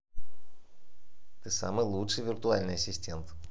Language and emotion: Russian, positive